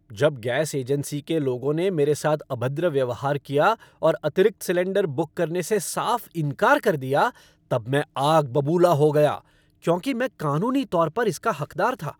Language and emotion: Hindi, angry